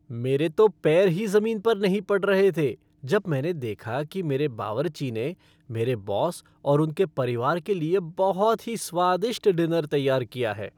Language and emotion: Hindi, happy